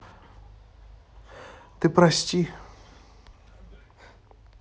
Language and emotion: Russian, sad